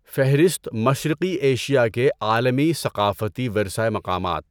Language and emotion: Urdu, neutral